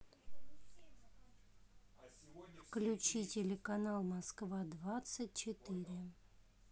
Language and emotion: Russian, neutral